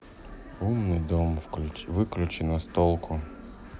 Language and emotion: Russian, sad